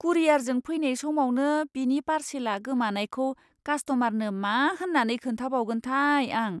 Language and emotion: Bodo, fearful